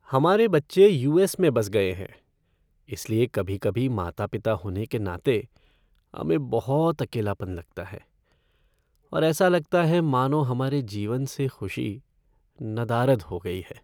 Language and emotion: Hindi, sad